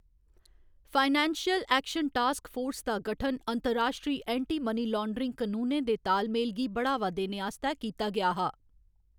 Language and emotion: Dogri, neutral